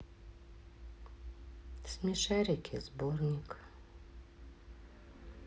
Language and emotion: Russian, sad